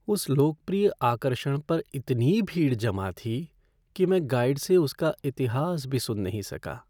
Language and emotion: Hindi, sad